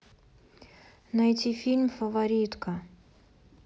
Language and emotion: Russian, neutral